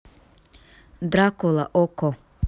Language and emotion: Russian, neutral